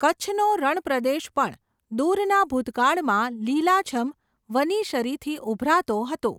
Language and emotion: Gujarati, neutral